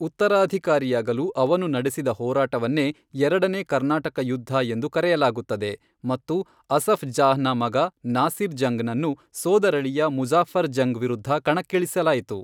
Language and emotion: Kannada, neutral